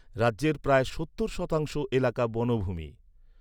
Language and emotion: Bengali, neutral